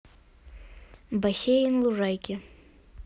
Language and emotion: Russian, neutral